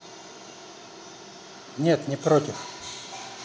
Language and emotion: Russian, neutral